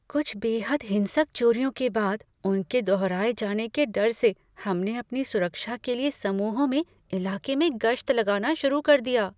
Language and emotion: Hindi, fearful